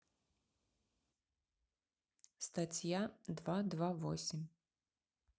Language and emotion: Russian, neutral